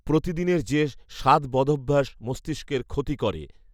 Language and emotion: Bengali, neutral